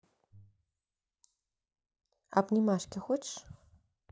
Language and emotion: Russian, neutral